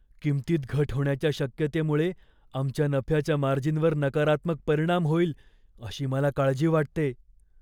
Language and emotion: Marathi, fearful